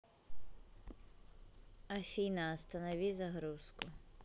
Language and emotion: Russian, neutral